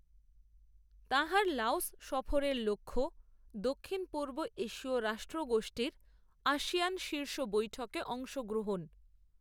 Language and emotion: Bengali, neutral